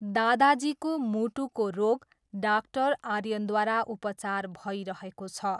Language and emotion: Nepali, neutral